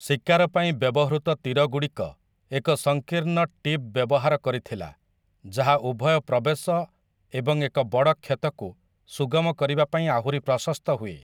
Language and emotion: Odia, neutral